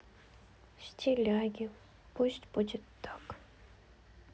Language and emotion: Russian, sad